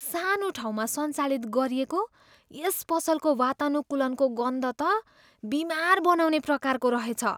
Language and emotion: Nepali, disgusted